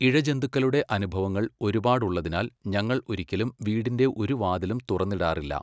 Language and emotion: Malayalam, neutral